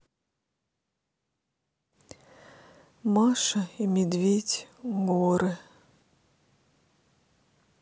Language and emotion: Russian, sad